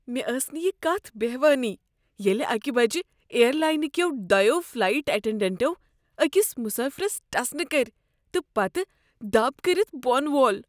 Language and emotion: Kashmiri, disgusted